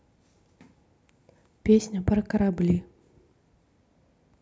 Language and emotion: Russian, neutral